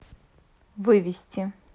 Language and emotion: Russian, neutral